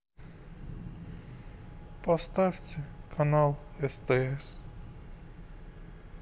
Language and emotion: Russian, sad